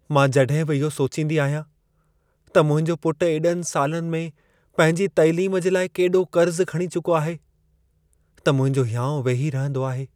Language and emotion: Sindhi, sad